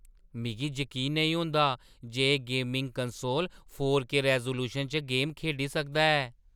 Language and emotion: Dogri, surprised